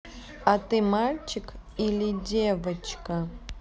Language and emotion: Russian, neutral